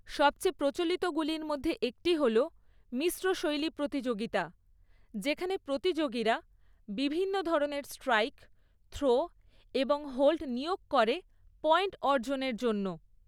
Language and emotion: Bengali, neutral